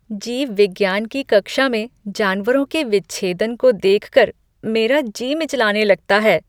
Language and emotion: Hindi, disgusted